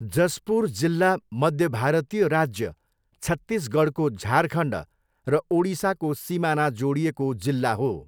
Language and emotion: Nepali, neutral